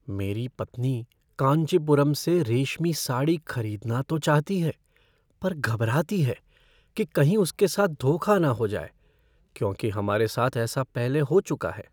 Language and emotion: Hindi, fearful